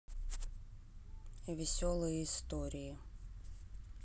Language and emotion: Russian, neutral